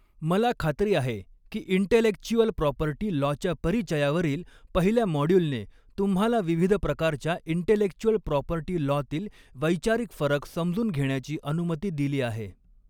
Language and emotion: Marathi, neutral